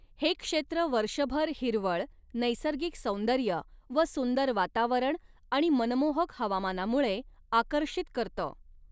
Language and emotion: Marathi, neutral